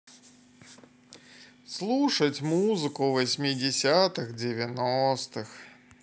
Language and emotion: Russian, sad